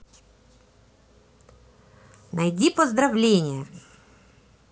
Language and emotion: Russian, neutral